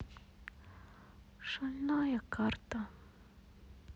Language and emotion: Russian, sad